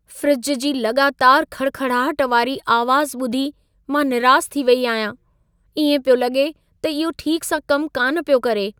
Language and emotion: Sindhi, sad